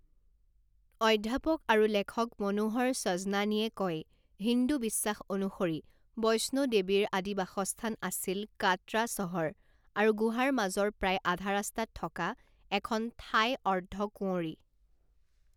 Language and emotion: Assamese, neutral